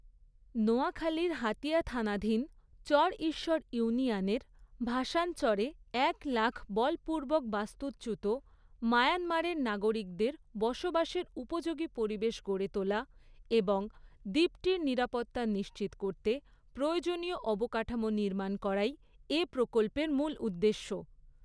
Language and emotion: Bengali, neutral